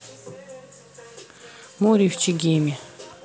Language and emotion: Russian, neutral